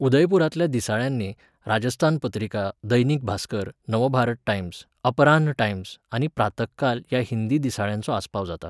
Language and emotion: Goan Konkani, neutral